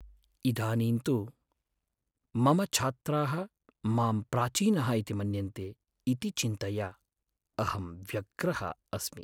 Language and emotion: Sanskrit, sad